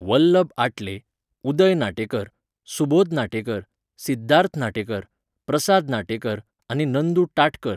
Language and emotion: Goan Konkani, neutral